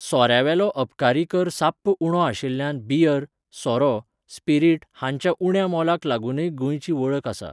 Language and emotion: Goan Konkani, neutral